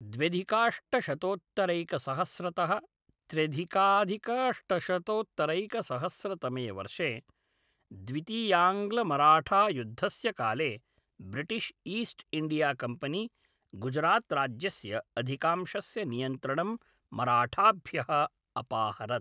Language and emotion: Sanskrit, neutral